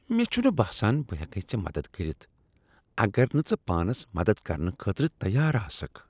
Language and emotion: Kashmiri, disgusted